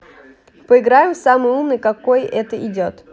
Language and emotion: Russian, positive